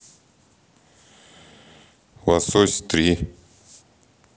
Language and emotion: Russian, neutral